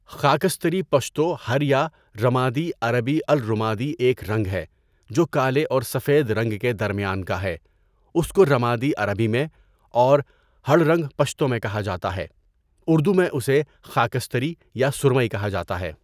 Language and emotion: Urdu, neutral